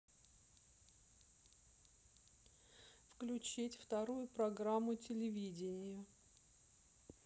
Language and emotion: Russian, neutral